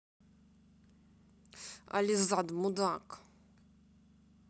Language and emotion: Russian, angry